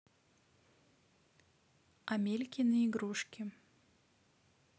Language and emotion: Russian, neutral